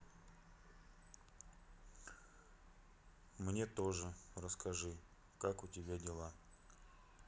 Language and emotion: Russian, sad